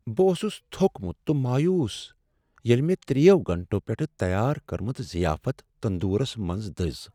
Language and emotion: Kashmiri, sad